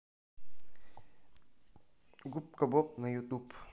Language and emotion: Russian, neutral